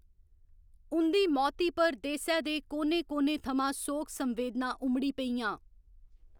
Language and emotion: Dogri, neutral